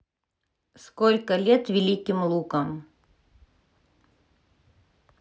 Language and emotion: Russian, neutral